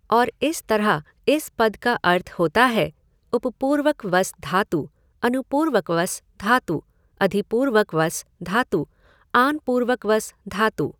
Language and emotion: Hindi, neutral